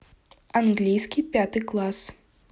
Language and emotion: Russian, neutral